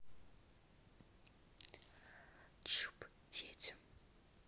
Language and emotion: Russian, neutral